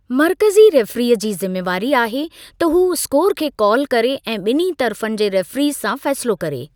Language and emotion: Sindhi, neutral